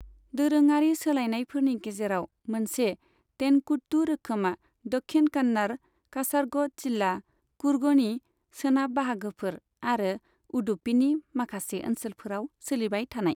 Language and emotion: Bodo, neutral